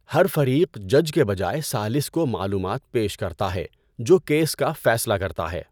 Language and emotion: Urdu, neutral